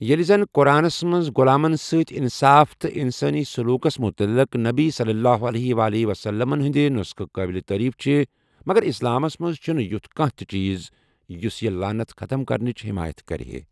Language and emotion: Kashmiri, neutral